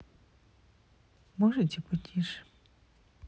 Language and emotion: Russian, neutral